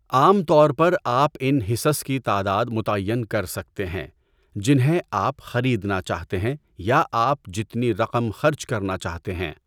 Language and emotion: Urdu, neutral